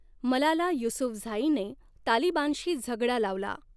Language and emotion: Marathi, neutral